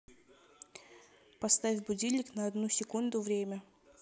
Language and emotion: Russian, neutral